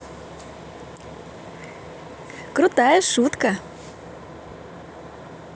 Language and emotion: Russian, positive